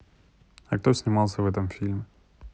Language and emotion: Russian, neutral